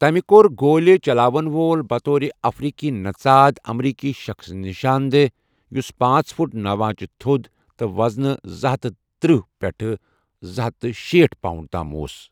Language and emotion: Kashmiri, neutral